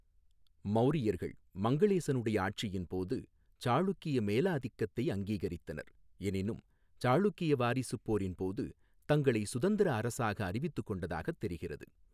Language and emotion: Tamil, neutral